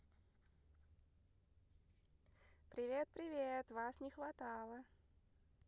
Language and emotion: Russian, positive